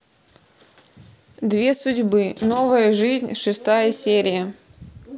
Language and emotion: Russian, neutral